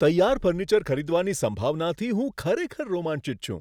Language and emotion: Gujarati, surprised